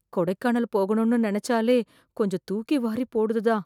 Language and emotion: Tamil, fearful